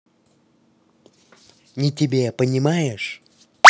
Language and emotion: Russian, angry